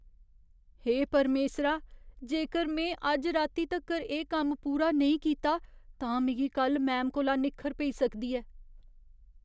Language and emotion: Dogri, fearful